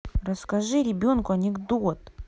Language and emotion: Russian, angry